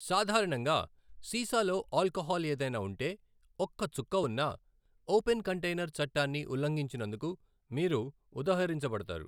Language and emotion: Telugu, neutral